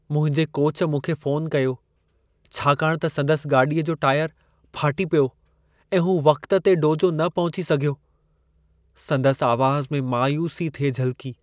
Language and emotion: Sindhi, sad